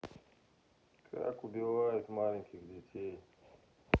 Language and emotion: Russian, neutral